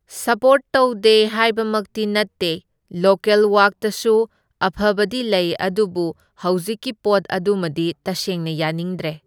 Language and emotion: Manipuri, neutral